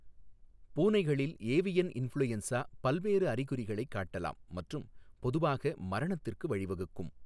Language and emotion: Tamil, neutral